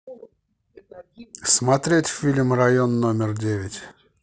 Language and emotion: Russian, neutral